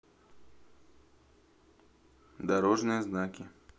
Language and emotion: Russian, neutral